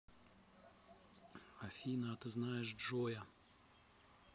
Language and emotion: Russian, neutral